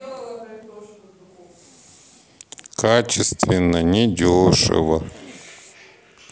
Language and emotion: Russian, sad